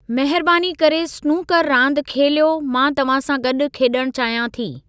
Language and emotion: Sindhi, neutral